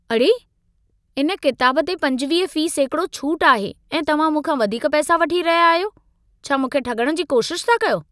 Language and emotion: Sindhi, angry